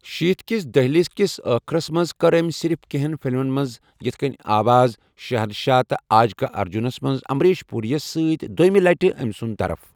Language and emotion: Kashmiri, neutral